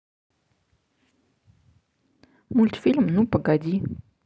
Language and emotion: Russian, neutral